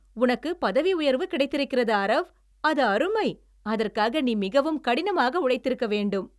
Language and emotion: Tamil, happy